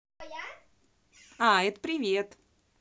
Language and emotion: Russian, positive